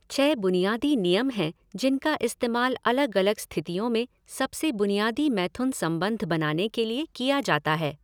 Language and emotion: Hindi, neutral